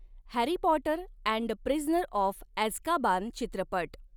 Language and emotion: Marathi, neutral